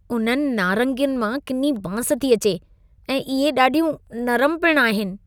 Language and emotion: Sindhi, disgusted